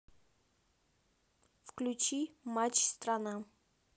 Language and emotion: Russian, neutral